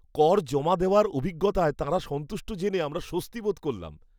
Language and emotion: Bengali, happy